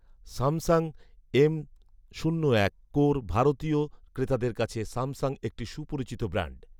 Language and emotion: Bengali, neutral